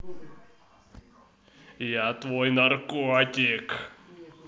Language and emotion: Russian, positive